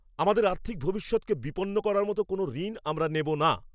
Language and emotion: Bengali, angry